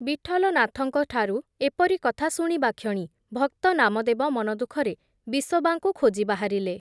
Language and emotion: Odia, neutral